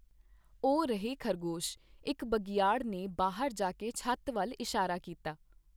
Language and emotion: Punjabi, neutral